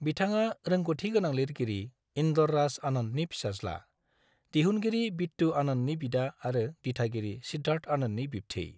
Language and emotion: Bodo, neutral